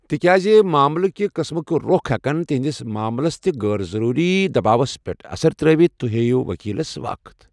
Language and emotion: Kashmiri, neutral